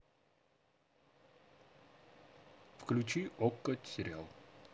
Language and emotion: Russian, neutral